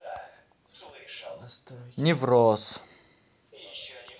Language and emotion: Russian, neutral